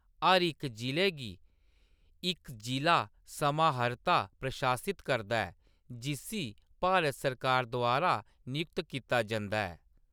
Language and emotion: Dogri, neutral